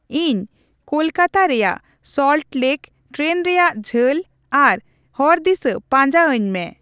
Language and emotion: Santali, neutral